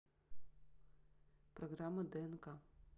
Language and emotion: Russian, neutral